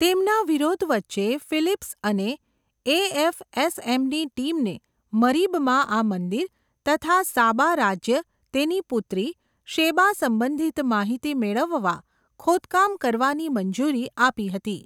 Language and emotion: Gujarati, neutral